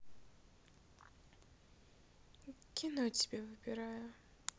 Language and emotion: Russian, sad